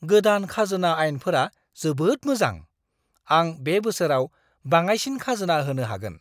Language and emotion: Bodo, surprised